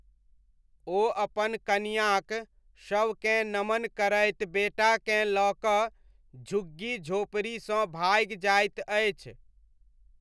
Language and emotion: Maithili, neutral